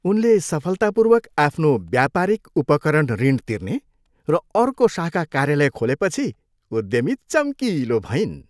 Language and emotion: Nepali, happy